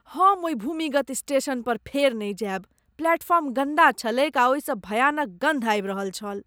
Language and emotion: Maithili, disgusted